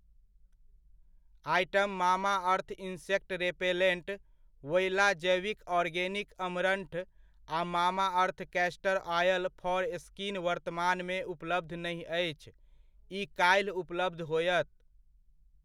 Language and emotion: Maithili, neutral